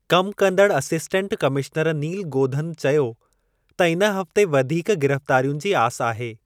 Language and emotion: Sindhi, neutral